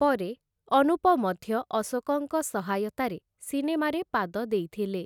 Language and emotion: Odia, neutral